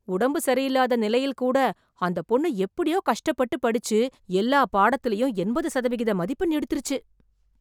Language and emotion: Tamil, surprised